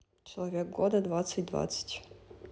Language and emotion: Russian, neutral